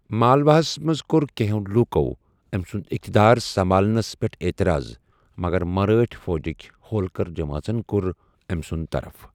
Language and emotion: Kashmiri, neutral